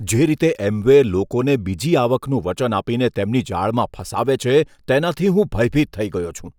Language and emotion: Gujarati, disgusted